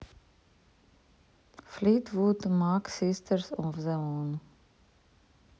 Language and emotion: Russian, neutral